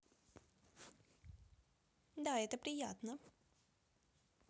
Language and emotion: Russian, positive